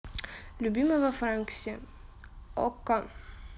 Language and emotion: Russian, neutral